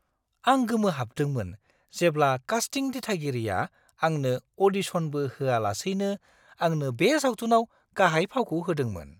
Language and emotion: Bodo, surprised